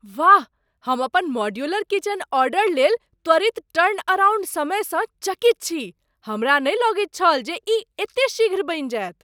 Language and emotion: Maithili, surprised